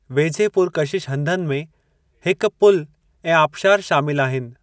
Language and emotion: Sindhi, neutral